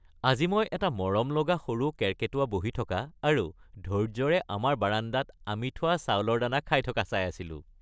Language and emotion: Assamese, happy